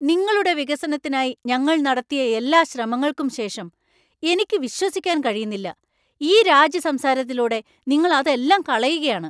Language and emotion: Malayalam, angry